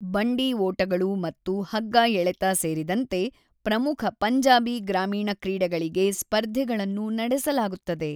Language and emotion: Kannada, neutral